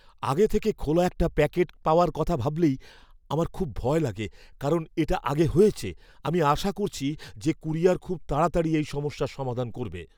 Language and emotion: Bengali, fearful